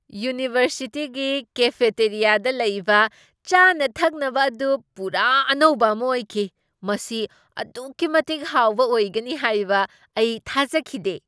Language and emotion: Manipuri, surprised